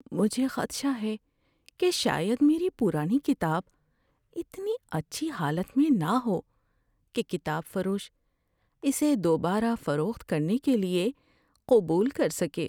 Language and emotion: Urdu, fearful